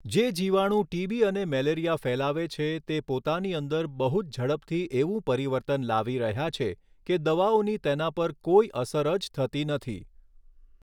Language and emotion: Gujarati, neutral